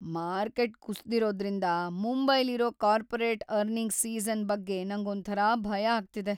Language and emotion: Kannada, fearful